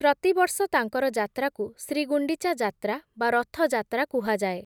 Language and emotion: Odia, neutral